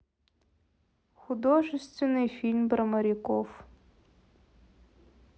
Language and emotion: Russian, sad